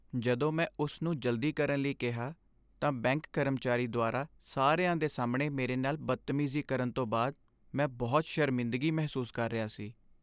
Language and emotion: Punjabi, sad